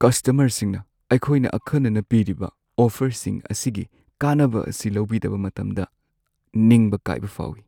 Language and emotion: Manipuri, sad